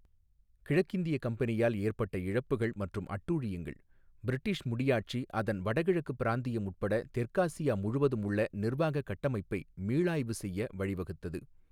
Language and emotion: Tamil, neutral